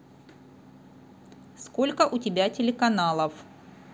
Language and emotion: Russian, neutral